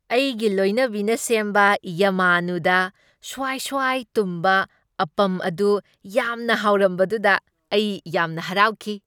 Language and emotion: Manipuri, happy